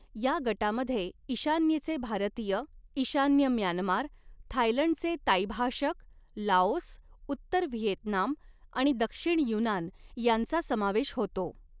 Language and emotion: Marathi, neutral